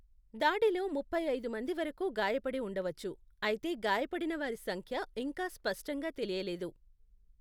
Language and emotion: Telugu, neutral